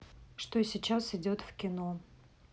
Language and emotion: Russian, neutral